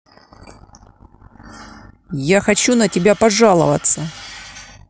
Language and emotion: Russian, angry